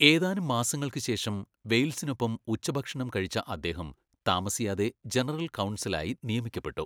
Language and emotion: Malayalam, neutral